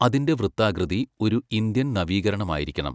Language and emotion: Malayalam, neutral